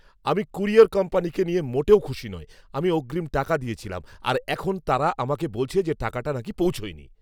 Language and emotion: Bengali, angry